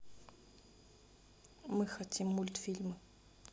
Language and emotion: Russian, neutral